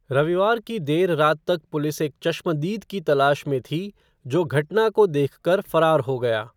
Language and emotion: Hindi, neutral